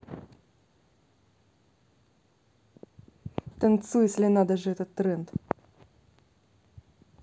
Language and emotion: Russian, neutral